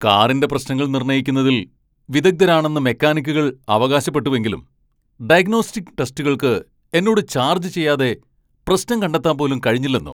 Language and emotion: Malayalam, angry